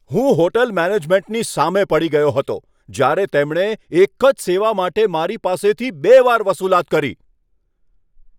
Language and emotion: Gujarati, angry